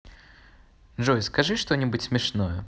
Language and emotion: Russian, neutral